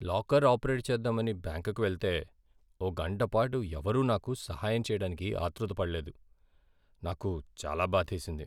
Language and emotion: Telugu, sad